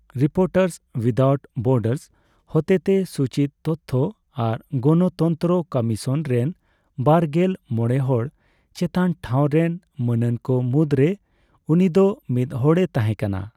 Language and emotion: Santali, neutral